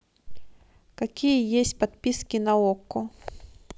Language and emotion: Russian, neutral